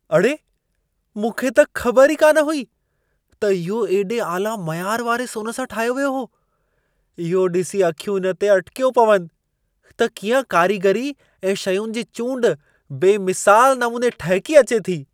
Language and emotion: Sindhi, surprised